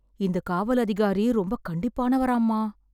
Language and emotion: Tamil, fearful